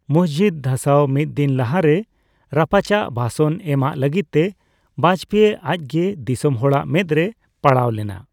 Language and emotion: Santali, neutral